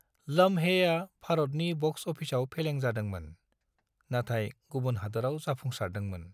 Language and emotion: Bodo, neutral